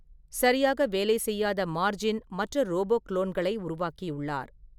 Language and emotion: Tamil, neutral